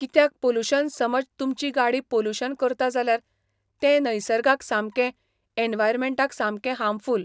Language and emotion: Goan Konkani, neutral